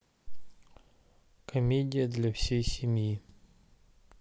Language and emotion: Russian, neutral